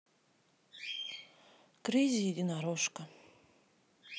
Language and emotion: Russian, sad